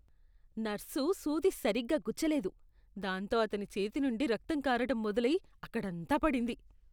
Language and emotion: Telugu, disgusted